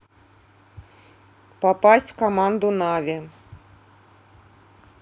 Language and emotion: Russian, neutral